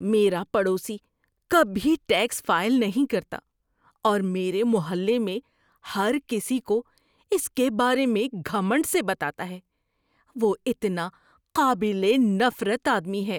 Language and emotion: Urdu, disgusted